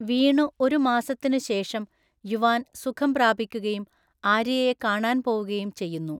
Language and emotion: Malayalam, neutral